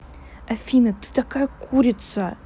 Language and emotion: Russian, angry